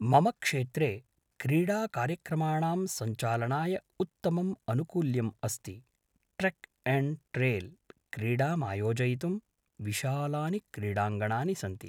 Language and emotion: Sanskrit, neutral